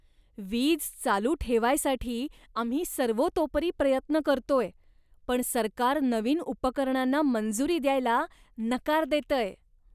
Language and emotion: Marathi, disgusted